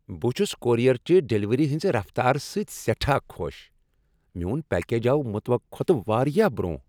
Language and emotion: Kashmiri, happy